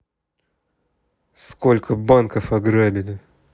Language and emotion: Russian, angry